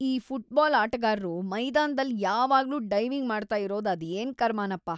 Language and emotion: Kannada, disgusted